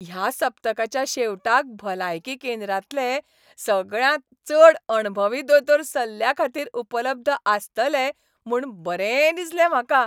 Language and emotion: Goan Konkani, happy